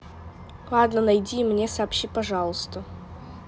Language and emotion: Russian, neutral